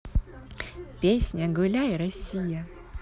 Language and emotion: Russian, positive